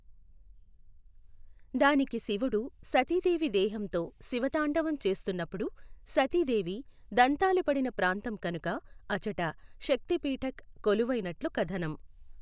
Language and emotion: Telugu, neutral